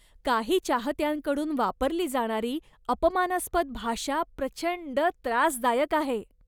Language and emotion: Marathi, disgusted